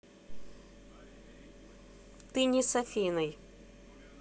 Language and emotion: Russian, neutral